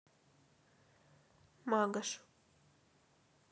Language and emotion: Russian, neutral